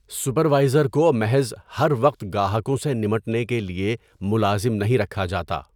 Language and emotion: Urdu, neutral